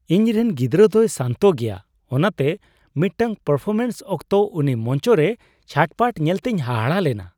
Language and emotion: Santali, surprised